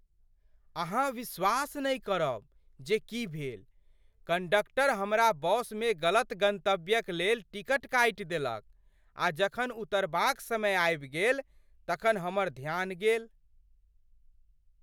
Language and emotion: Maithili, surprised